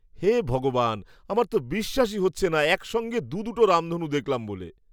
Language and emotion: Bengali, surprised